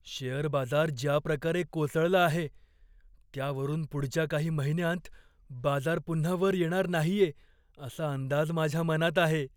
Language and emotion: Marathi, fearful